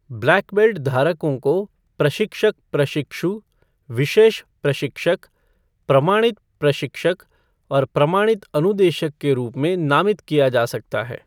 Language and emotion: Hindi, neutral